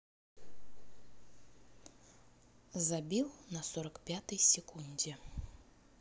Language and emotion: Russian, neutral